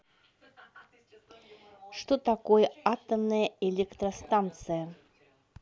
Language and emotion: Russian, neutral